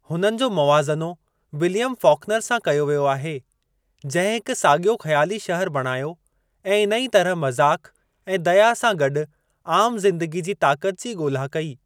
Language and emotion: Sindhi, neutral